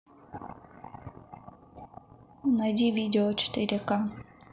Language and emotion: Russian, neutral